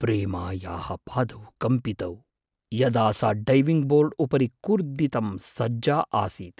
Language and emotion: Sanskrit, fearful